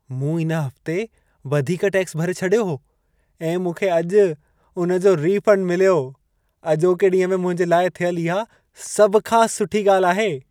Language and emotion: Sindhi, happy